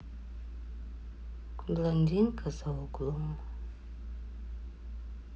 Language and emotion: Russian, sad